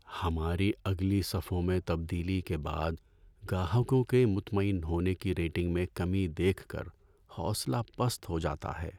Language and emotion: Urdu, sad